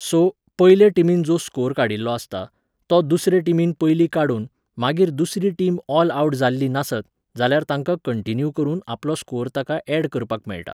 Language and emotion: Goan Konkani, neutral